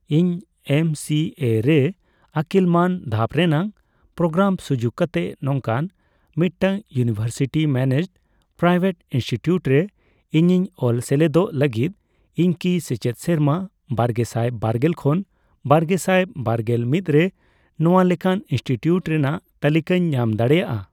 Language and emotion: Santali, neutral